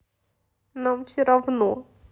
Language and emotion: Russian, sad